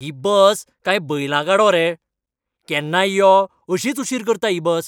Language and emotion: Goan Konkani, angry